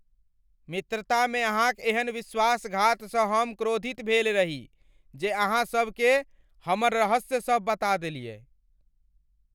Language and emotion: Maithili, angry